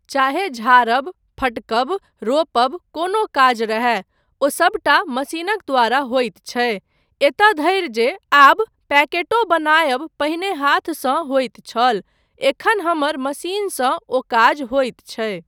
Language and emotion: Maithili, neutral